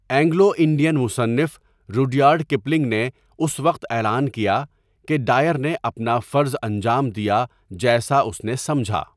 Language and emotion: Urdu, neutral